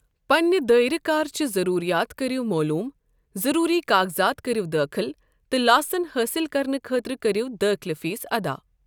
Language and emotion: Kashmiri, neutral